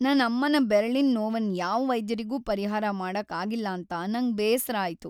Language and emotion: Kannada, sad